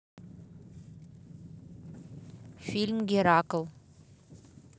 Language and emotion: Russian, neutral